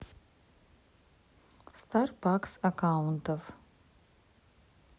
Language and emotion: Russian, neutral